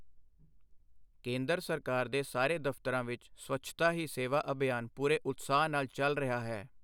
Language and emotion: Punjabi, neutral